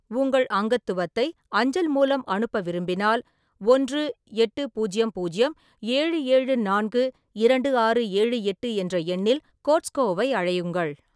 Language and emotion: Tamil, neutral